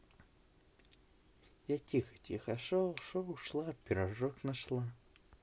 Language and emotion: Russian, positive